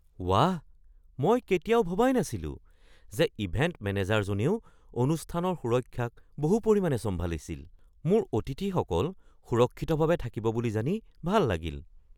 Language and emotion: Assamese, surprised